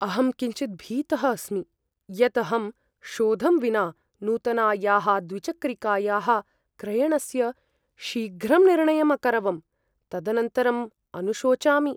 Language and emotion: Sanskrit, fearful